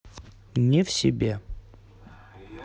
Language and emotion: Russian, neutral